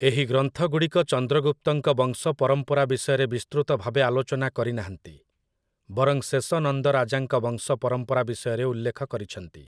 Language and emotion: Odia, neutral